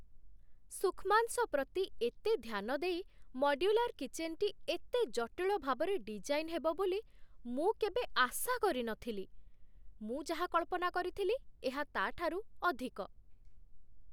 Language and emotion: Odia, surprised